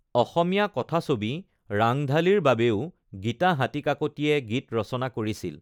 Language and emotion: Assamese, neutral